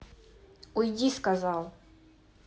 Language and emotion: Russian, angry